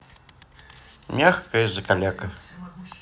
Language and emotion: Russian, neutral